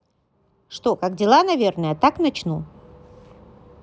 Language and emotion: Russian, positive